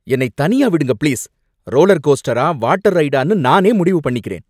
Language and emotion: Tamil, angry